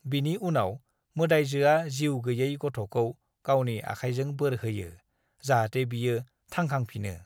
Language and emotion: Bodo, neutral